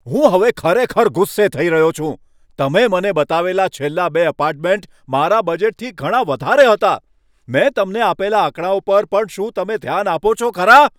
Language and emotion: Gujarati, angry